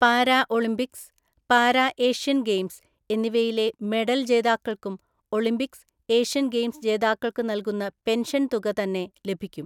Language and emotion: Malayalam, neutral